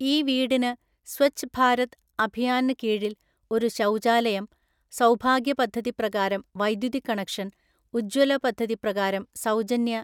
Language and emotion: Malayalam, neutral